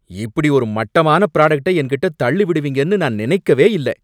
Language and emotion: Tamil, angry